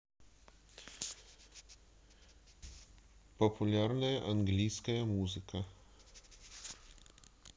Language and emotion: Russian, neutral